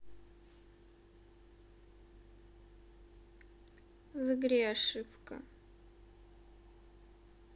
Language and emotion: Russian, sad